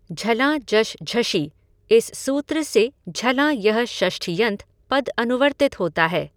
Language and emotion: Hindi, neutral